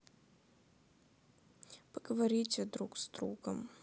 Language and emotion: Russian, sad